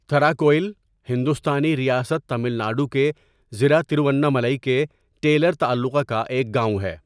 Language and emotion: Urdu, neutral